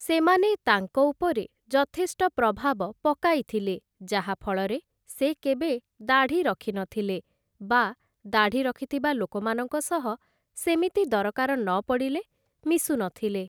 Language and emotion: Odia, neutral